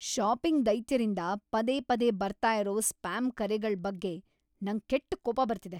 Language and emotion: Kannada, angry